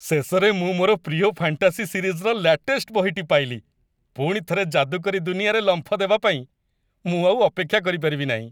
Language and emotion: Odia, happy